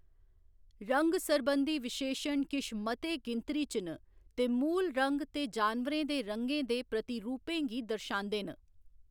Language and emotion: Dogri, neutral